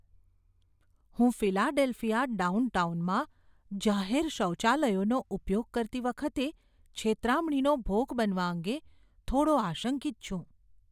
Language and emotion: Gujarati, fearful